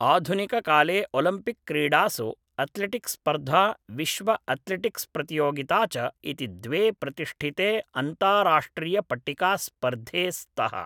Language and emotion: Sanskrit, neutral